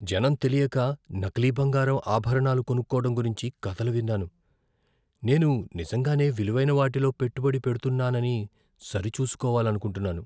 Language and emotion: Telugu, fearful